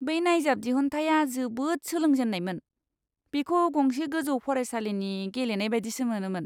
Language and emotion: Bodo, disgusted